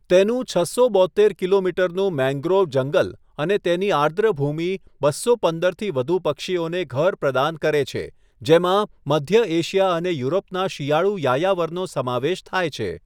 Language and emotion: Gujarati, neutral